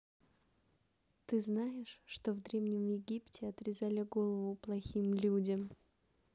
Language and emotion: Russian, neutral